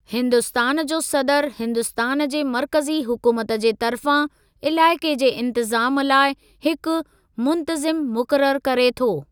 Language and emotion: Sindhi, neutral